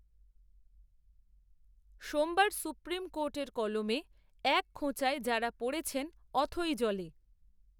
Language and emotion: Bengali, neutral